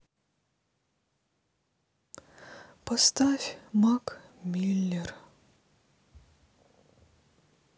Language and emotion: Russian, sad